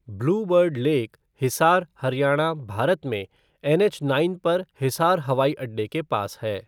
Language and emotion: Hindi, neutral